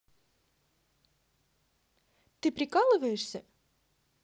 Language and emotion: Russian, neutral